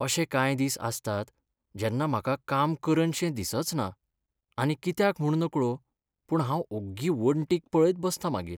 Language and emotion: Goan Konkani, sad